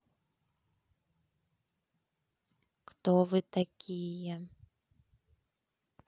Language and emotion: Russian, neutral